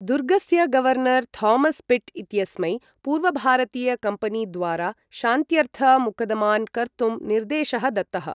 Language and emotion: Sanskrit, neutral